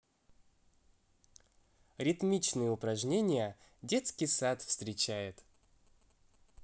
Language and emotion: Russian, positive